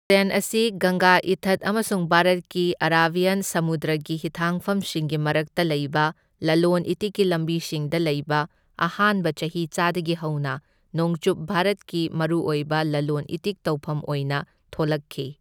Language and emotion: Manipuri, neutral